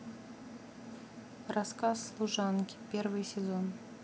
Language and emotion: Russian, neutral